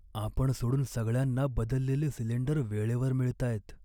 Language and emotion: Marathi, sad